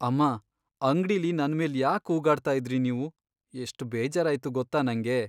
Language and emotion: Kannada, sad